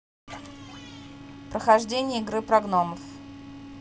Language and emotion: Russian, neutral